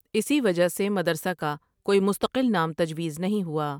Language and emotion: Urdu, neutral